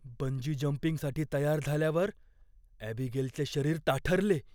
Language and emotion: Marathi, fearful